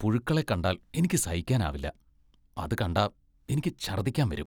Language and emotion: Malayalam, disgusted